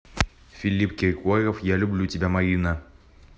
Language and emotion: Russian, neutral